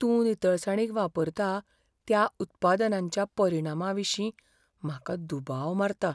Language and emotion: Goan Konkani, fearful